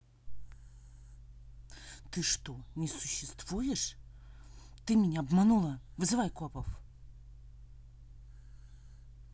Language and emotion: Russian, angry